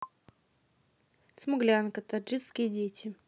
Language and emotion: Russian, neutral